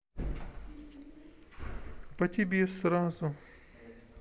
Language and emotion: Russian, neutral